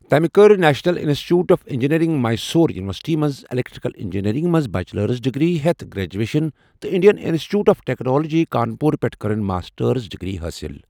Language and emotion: Kashmiri, neutral